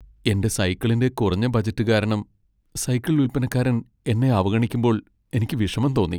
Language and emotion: Malayalam, sad